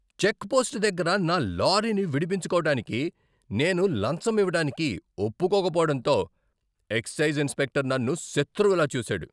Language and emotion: Telugu, angry